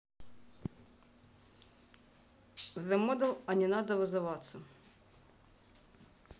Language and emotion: Russian, neutral